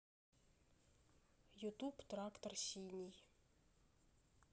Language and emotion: Russian, neutral